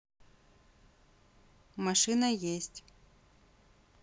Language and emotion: Russian, neutral